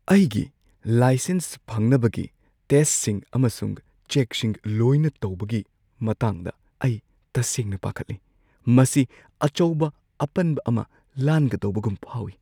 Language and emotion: Manipuri, fearful